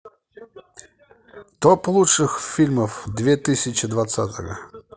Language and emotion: Russian, positive